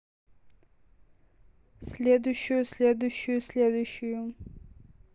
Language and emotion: Russian, neutral